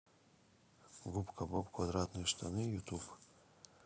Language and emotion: Russian, neutral